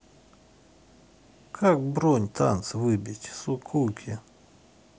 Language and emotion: Russian, neutral